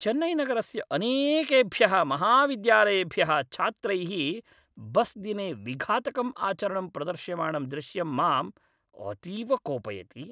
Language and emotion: Sanskrit, angry